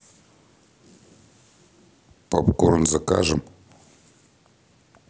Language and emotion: Russian, neutral